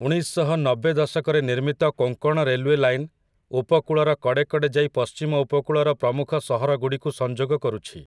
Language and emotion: Odia, neutral